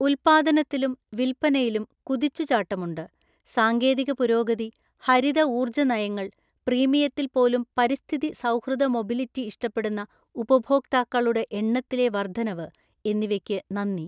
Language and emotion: Malayalam, neutral